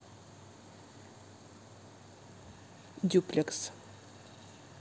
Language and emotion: Russian, neutral